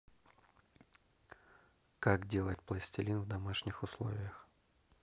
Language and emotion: Russian, neutral